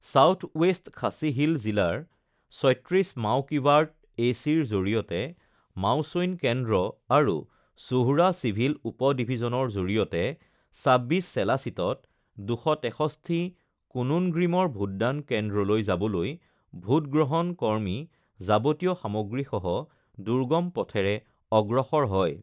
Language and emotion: Assamese, neutral